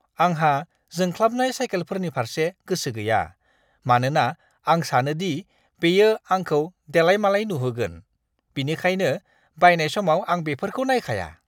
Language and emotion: Bodo, disgusted